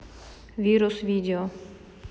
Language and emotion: Russian, neutral